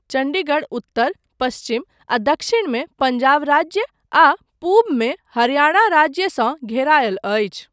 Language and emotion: Maithili, neutral